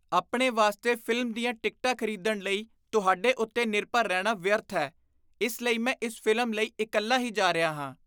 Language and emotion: Punjabi, disgusted